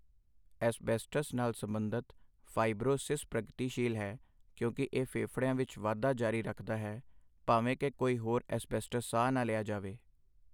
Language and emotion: Punjabi, neutral